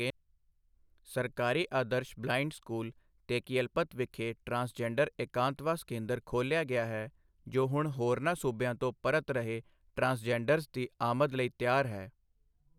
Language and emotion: Punjabi, neutral